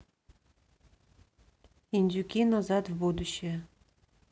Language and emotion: Russian, neutral